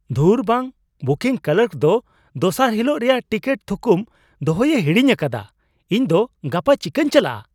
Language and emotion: Santali, surprised